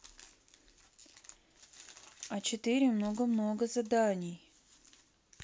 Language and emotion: Russian, neutral